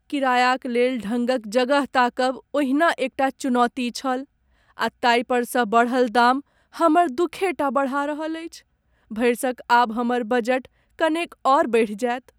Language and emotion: Maithili, sad